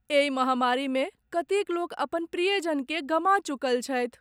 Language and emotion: Maithili, sad